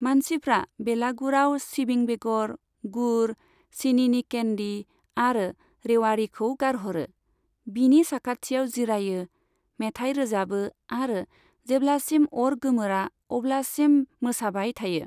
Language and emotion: Bodo, neutral